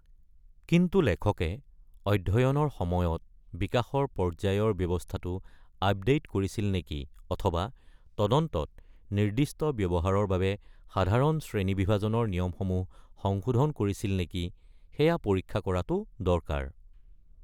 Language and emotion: Assamese, neutral